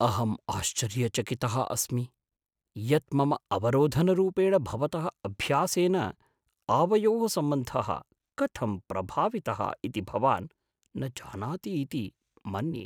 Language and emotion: Sanskrit, surprised